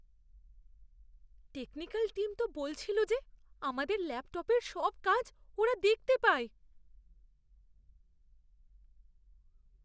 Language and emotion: Bengali, fearful